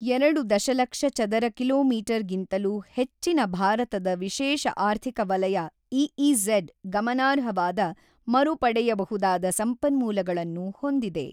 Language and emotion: Kannada, neutral